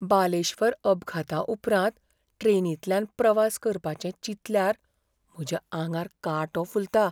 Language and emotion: Goan Konkani, fearful